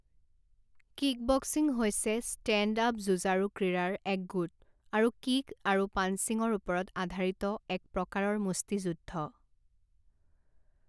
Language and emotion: Assamese, neutral